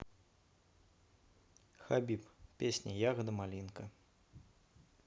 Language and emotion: Russian, neutral